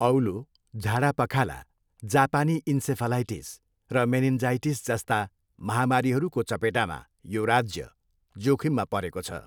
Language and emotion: Nepali, neutral